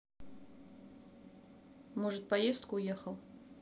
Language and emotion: Russian, neutral